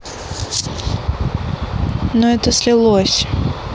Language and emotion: Russian, neutral